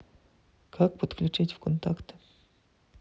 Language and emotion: Russian, neutral